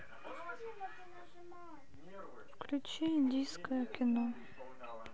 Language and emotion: Russian, sad